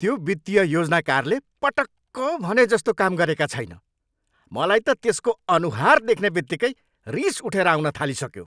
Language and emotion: Nepali, angry